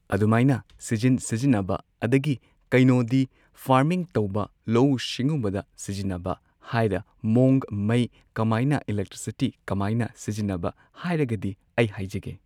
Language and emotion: Manipuri, neutral